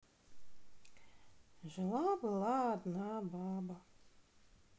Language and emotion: Russian, sad